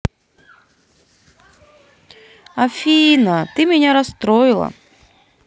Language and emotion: Russian, sad